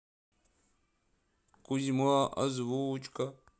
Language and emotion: Russian, sad